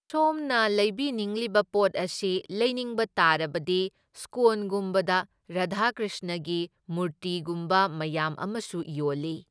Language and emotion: Manipuri, neutral